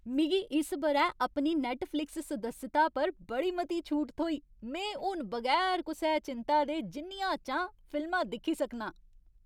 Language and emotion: Dogri, happy